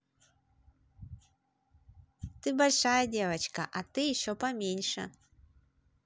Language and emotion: Russian, positive